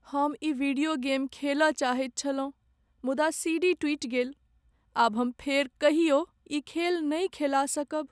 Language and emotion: Maithili, sad